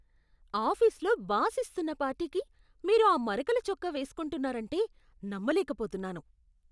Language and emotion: Telugu, disgusted